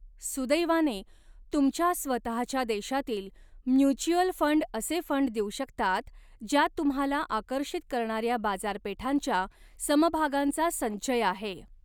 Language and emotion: Marathi, neutral